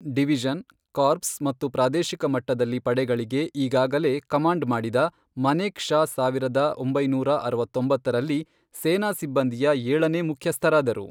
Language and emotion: Kannada, neutral